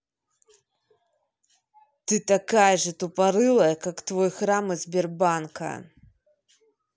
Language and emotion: Russian, angry